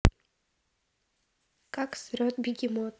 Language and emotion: Russian, neutral